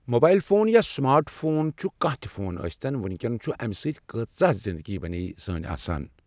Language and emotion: Kashmiri, neutral